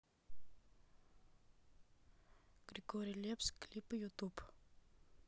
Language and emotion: Russian, neutral